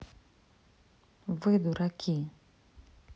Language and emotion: Russian, neutral